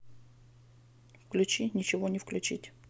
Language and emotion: Russian, neutral